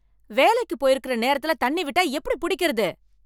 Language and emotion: Tamil, angry